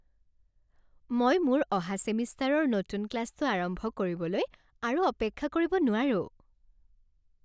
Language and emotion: Assamese, happy